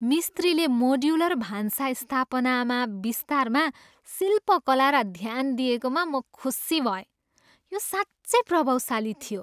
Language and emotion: Nepali, happy